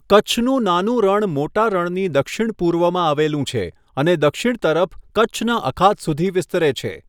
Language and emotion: Gujarati, neutral